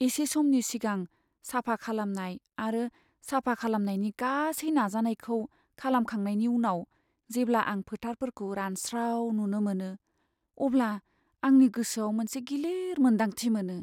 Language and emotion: Bodo, sad